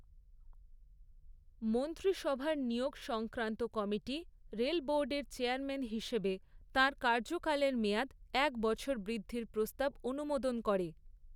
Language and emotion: Bengali, neutral